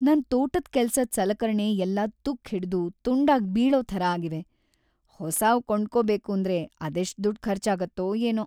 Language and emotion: Kannada, sad